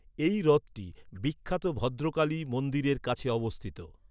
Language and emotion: Bengali, neutral